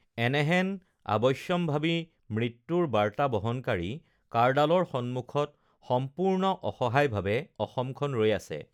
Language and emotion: Assamese, neutral